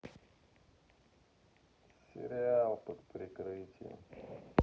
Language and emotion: Russian, sad